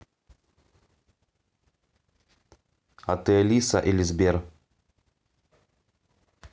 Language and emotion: Russian, neutral